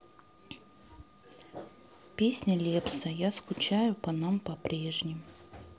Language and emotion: Russian, sad